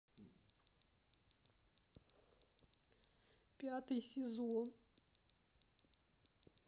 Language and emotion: Russian, sad